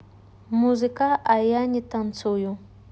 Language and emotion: Russian, neutral